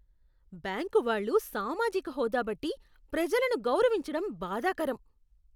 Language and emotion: Telugu, disgusted